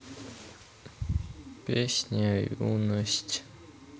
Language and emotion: Russian, neutral